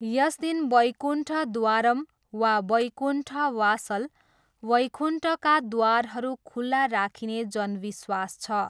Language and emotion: Nepali, neutral